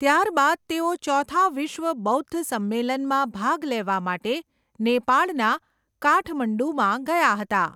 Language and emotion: Gujarati, neutral